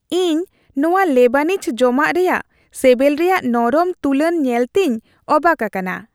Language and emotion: Santali, happy